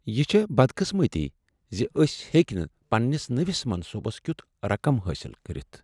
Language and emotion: Kashmiri, sad